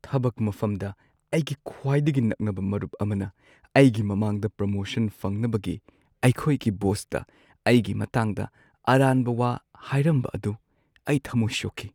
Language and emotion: Manipuri, sad